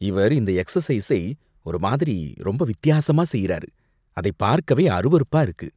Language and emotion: Tamil, disgusted